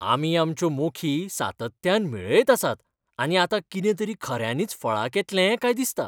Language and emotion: Goan Konkani, happy